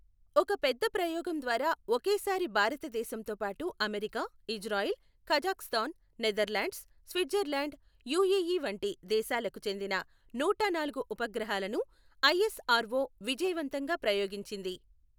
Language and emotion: Telugu, neutral